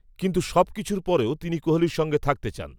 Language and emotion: Bengali, neutral